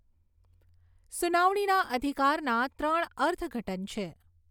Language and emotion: Gujarati, neutral